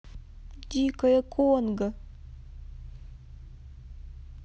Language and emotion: Russian, sad